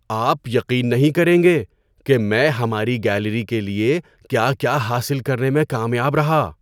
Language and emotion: Urdu, surprised